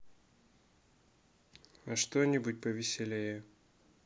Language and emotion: Russian, sad